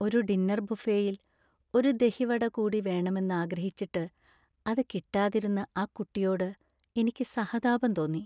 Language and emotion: Malayalam, sad